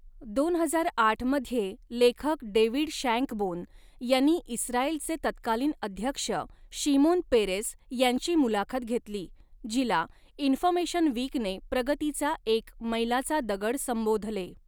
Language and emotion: Marathi, neutral